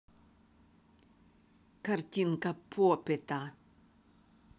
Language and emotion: Russian, neutral